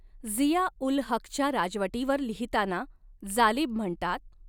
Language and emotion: Marathi, neutral